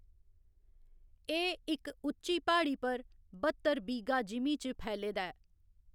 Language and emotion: Dogri, neutral